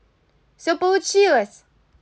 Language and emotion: Russian, positive